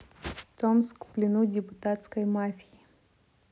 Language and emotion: Russian, neutral